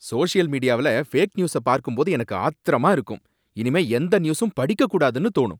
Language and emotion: Tamil, angry